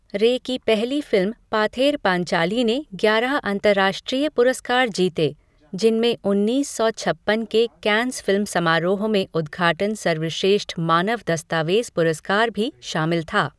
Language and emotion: Hindi, neutral